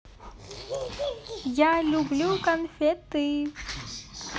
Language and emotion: Russian, positive